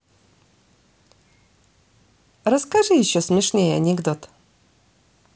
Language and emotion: Russian, positive